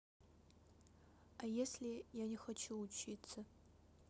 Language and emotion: Russian, sad